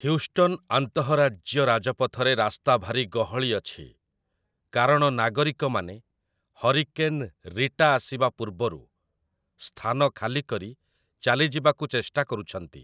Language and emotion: Odia, neutral